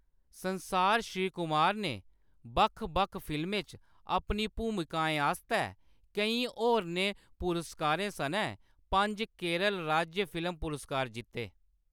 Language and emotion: Dogri, neutral